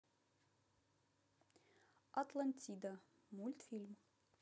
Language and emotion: Russian, neutral